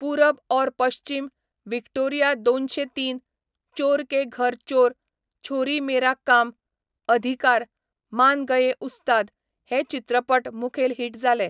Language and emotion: Goan Konkani, neutral